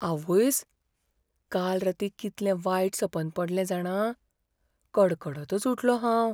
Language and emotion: Goan Konkani, fearful